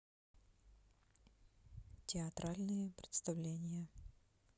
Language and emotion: Russian, neutral